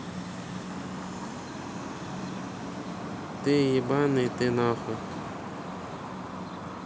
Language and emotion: Russian, neutral